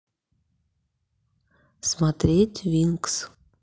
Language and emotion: Russian, neutral